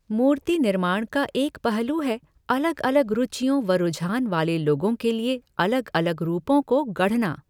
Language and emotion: Hindi, neutral